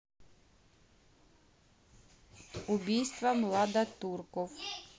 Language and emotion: Russian, neutral